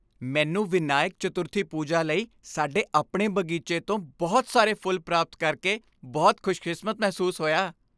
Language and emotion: Punjabi, happy